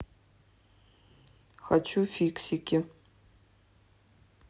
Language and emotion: Russian, neutral